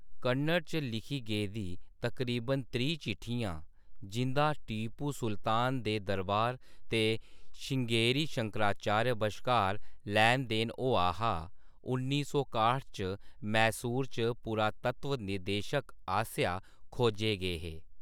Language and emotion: Dogri, neutral